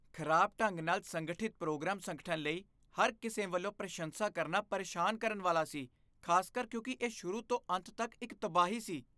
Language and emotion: Punjabi, disgusted